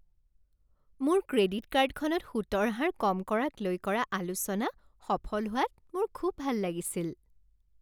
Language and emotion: Assamese, happy